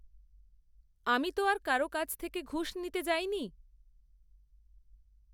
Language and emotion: Bengali, neutral